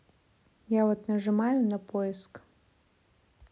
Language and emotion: Russian, neutral